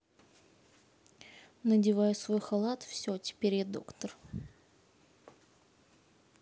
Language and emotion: Russian, neutral